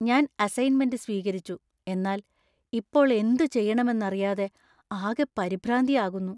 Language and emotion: Malayalam, fearful